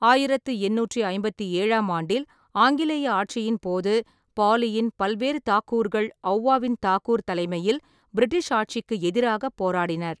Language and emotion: Tamil, neutral